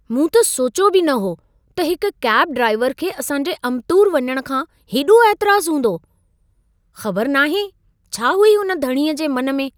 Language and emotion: Sindhi, surprised